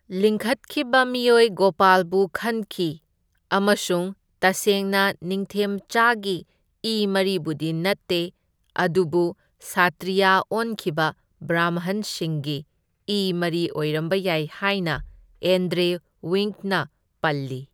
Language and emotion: Manipuri, neutral